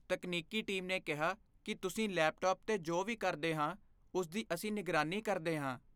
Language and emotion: Punjabi, fearful